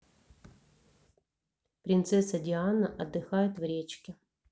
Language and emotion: Russian, neutral